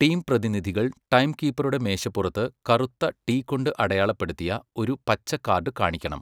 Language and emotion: Malayalam, neutral